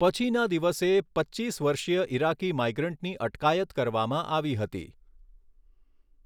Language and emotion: Gujarati, neutral